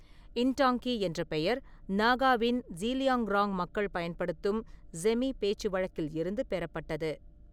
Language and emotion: Tamil, neutral